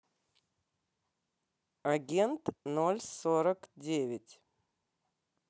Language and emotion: Russian, neutral